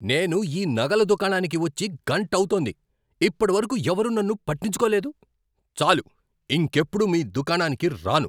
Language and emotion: Telugu, angry